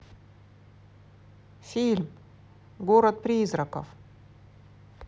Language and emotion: Russian, positive